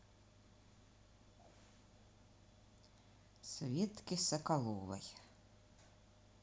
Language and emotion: Russian, neutral